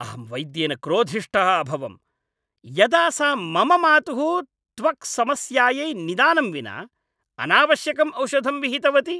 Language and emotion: Sanskrit, angry